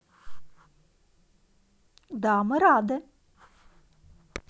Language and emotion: Russian, positive